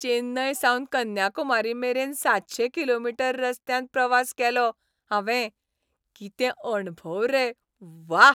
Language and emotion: Goan Konkani, happy